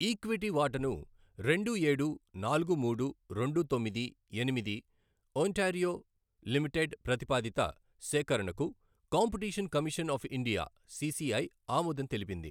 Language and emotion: Telugu, neutral